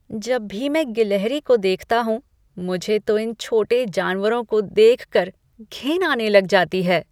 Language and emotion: Hindi, disgusted